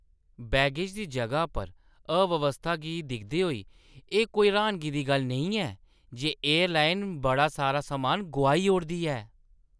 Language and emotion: Dogri, disgusted